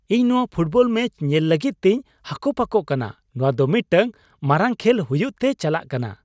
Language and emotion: Santali, happy